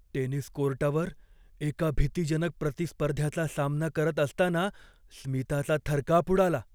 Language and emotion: Marathi, fearful